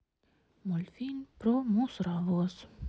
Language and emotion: Russian, sad